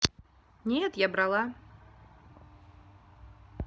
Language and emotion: Russian, neutral